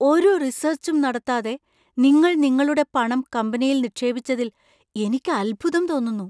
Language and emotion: Malayalam, surprised